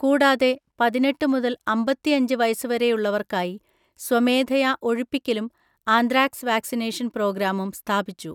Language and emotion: Malayalam, neutral